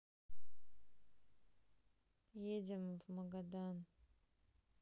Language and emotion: Russian, neutral